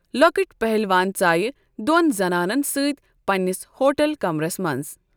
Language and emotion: Kashmiri, neutral